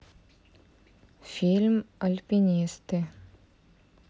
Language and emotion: Russian, neutral